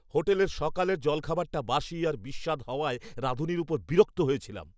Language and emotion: Bengali, angry